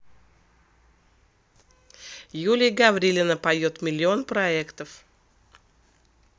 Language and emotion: Russian, neutral